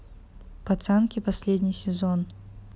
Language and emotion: Russian, neutral